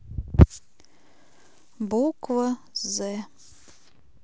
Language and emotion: Russian, neutral